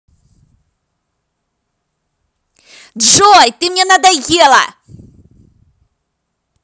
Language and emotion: Russian, angry